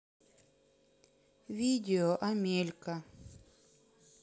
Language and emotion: Russian, neutral